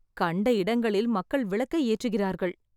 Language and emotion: Tamil, sad